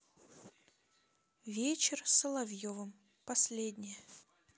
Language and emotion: Russian, neutral